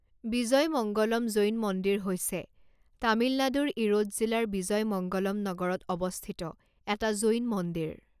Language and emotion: Assamese, neutral